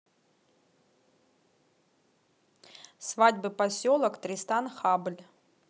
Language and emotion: Russian, neutral